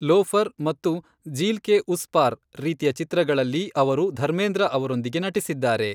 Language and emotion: Kannada, neutral